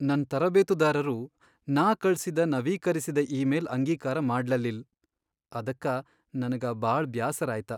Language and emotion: Kannada, sad